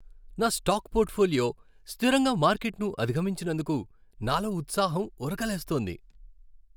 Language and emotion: Telugu, happy